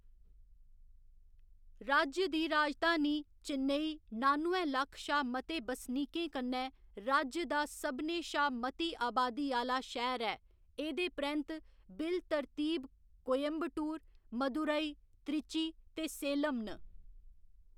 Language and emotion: Dogri, neutral